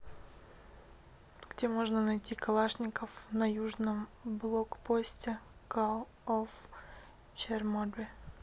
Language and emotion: Russian, neutral